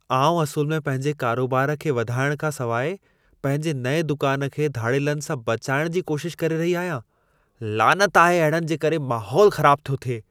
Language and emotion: Sindhi, disgusted